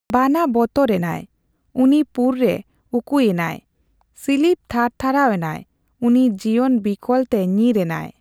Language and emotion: Santali, neutral